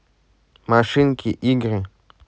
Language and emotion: Russian, neutral